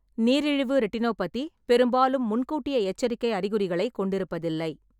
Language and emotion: Tamil, neutral